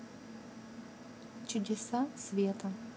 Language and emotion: Russian, neutral